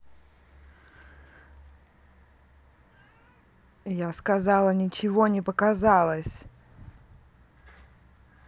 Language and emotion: Russian, angry